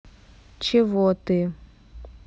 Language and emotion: Russian, neutral